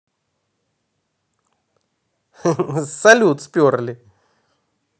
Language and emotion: Russian, positive